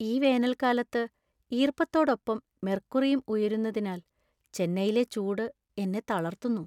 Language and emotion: Malayalam, sad